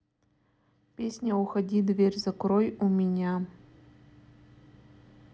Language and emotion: Russian, neutral